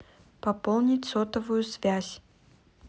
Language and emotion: Russian, neutral